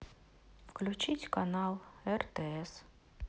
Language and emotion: Russian, sad